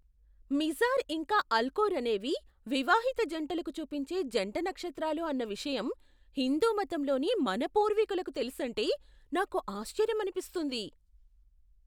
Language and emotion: Telugu, surprised